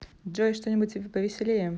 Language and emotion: Russian, neutral